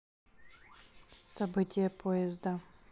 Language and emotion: Russian, neutral